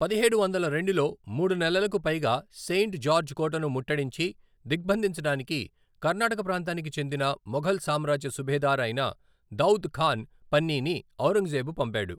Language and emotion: Telugu, neutral